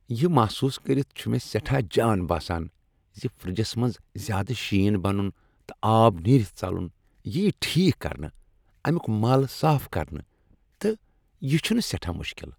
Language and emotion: Kashmiri, happy